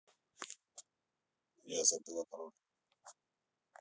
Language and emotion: Russian, neutral